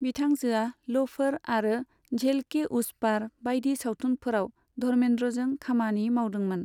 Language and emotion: Bodo, neutral